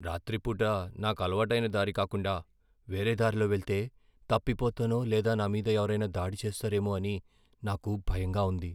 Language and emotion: Telugu, fearful